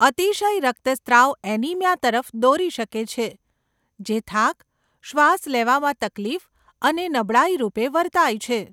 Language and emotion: Gujarati, neutral